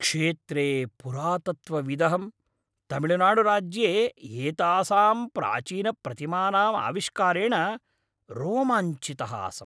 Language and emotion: Sanskrit, happy